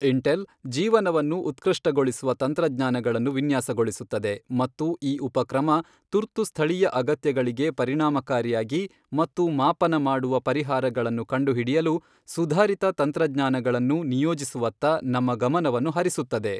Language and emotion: Kannada, neutral